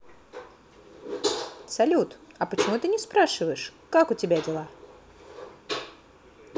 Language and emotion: Russian, positive